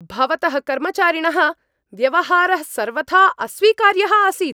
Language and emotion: Sanskrit, angry